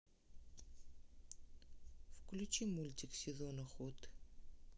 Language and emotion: Russian, neutral